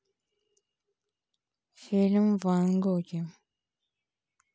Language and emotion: Russian, neutral